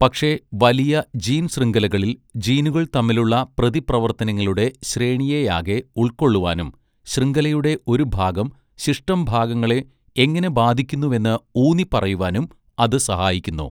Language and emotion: Malayalam, neutral